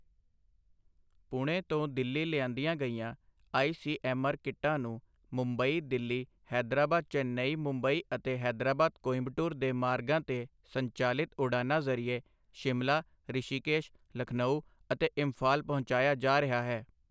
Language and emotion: Punjabi, neutral